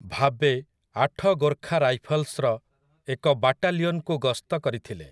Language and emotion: Odia, neutral